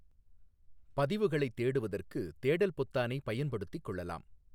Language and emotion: Tamil, neutral